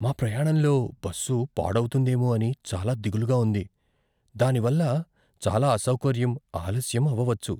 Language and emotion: Telugu, fearful